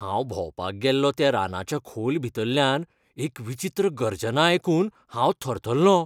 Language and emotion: Goan Konkani, fearful